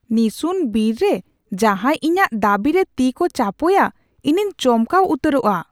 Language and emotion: Santali, surprised